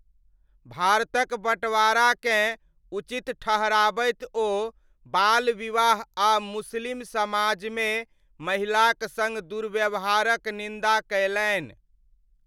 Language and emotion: Maithili, neutral